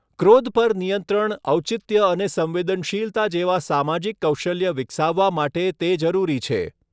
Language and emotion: Gujarati, neutral